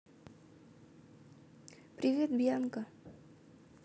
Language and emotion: Russian, neutral